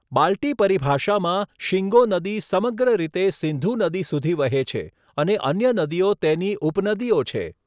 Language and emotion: Gujarati, neutral